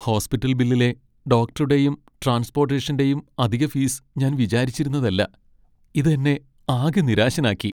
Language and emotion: Malayalam, sad